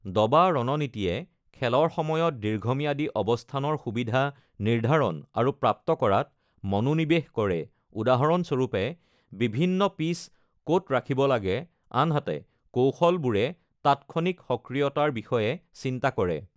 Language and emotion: Assamese, neutral